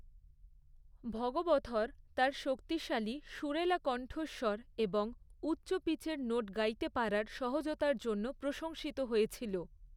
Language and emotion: Bengali, neutral